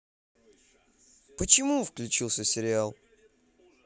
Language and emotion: Russian, neutral